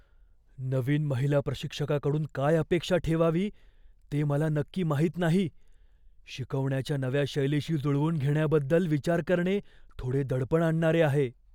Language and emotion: Marathi, fearful